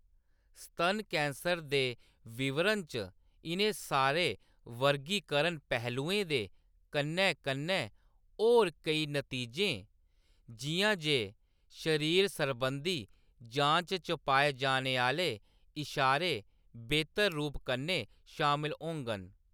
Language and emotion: Dogri, neutral